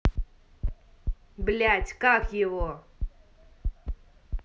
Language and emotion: Russian, angry